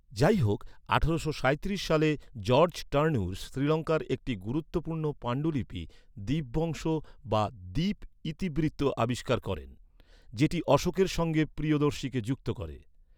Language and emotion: Bengali, neutral